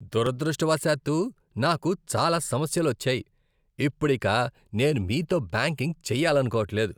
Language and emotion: Telugu, disgusted